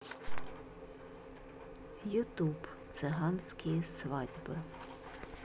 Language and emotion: Russian, neutral